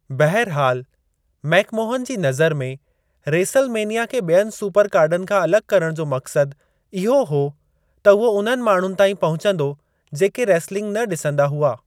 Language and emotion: Sindhi, neutral